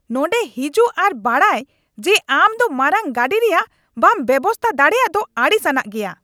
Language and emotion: Santali, angry